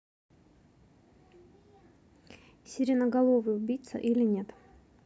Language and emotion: Russian, neutral